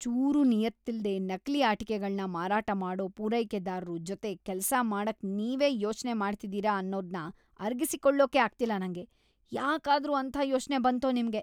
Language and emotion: Kannada, disgusted